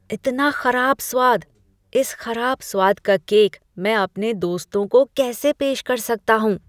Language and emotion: Hindi, disgusted